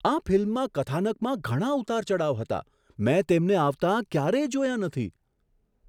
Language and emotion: Gujarati, surprised